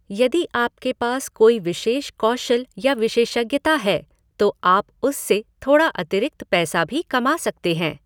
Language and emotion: Hindi, neutral